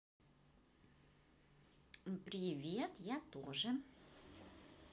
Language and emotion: Russian, positive